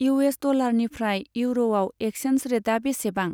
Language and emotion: Bodo, neutral